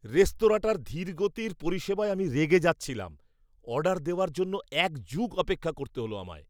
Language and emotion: Bengali, angry